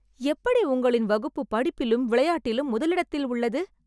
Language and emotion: Tamil, surprised